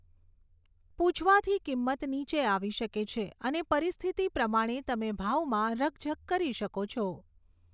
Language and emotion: Gujarati, neutral